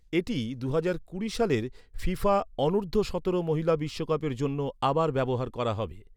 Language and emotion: Bengali, neutral